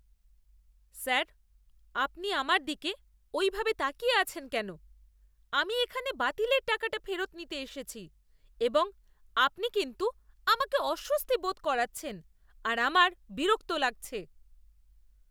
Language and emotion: Bengali, disgusted